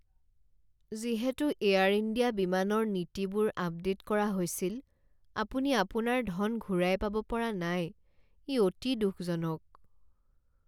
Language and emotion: Assamese, sad